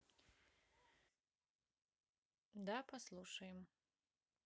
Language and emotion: Russian, neutral